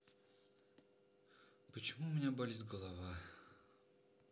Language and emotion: Russian, sad